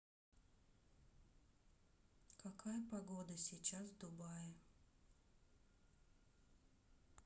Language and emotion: Russian, neutral